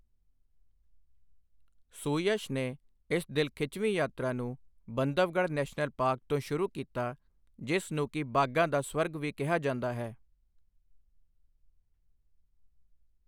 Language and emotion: Punjabi, neutral